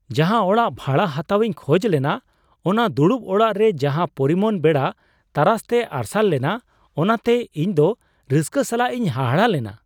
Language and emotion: Santali, surprised